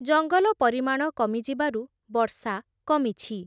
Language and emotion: Odia, neutral